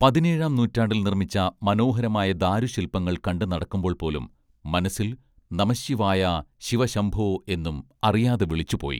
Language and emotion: Malayalam, neutral